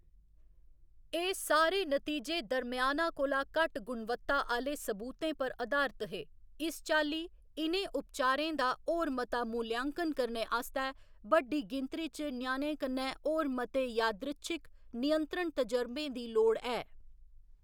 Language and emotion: Dogri, neutral